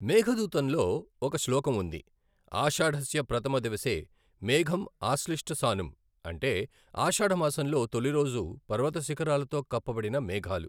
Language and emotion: Telugu, neutral